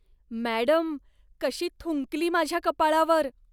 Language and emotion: Marathi, disgusted